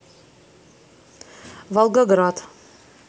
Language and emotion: Russian, neutral